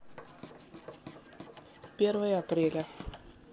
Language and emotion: Russian, neutral